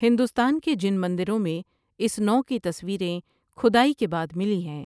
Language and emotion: Urdu, neutral